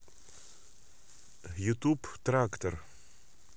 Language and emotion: Russian, neutral